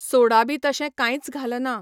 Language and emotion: Goan Konkani, neutral